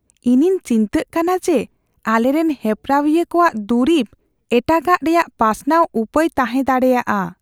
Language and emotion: Santali, fearful